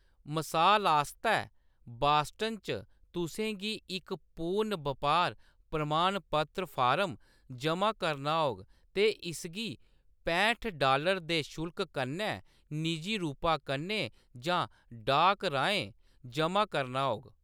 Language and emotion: Dogri, neutral